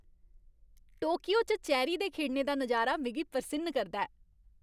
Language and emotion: Dogri, happy